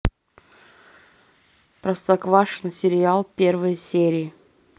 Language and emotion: Russian, neutral